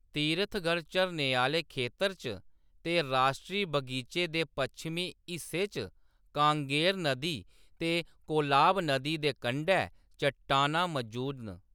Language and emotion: Dogri, neutral